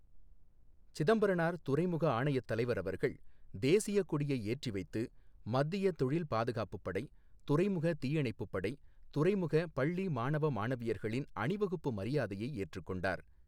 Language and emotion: Tamil, neutral